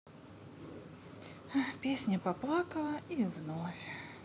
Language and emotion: Russian, sad